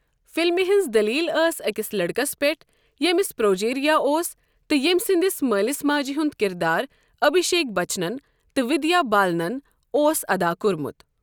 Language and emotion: Kashmiri, neutral